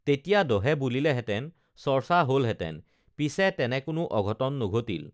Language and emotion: Assamese, neutral